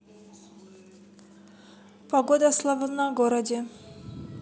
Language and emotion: Russian, neutral